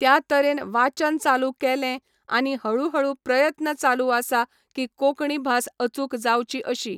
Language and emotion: Goan Konkani, neutral